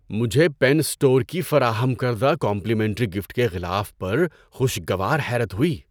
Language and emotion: Urdu, surprised